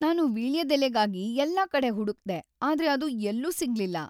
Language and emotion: Kannada, sad